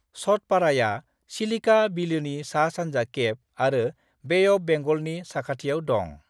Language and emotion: Bodo, neutral